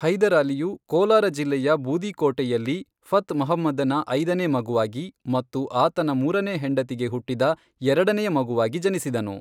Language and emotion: Kannada, neutral